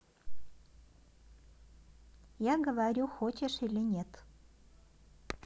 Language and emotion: Russian, neutral